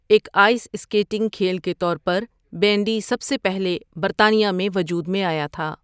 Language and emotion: Urdu, neutral